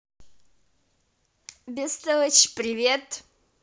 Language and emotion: Russian, positive